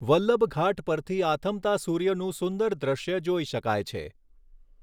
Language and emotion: Gujarati, neutral